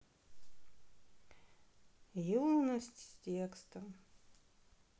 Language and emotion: Russian, sad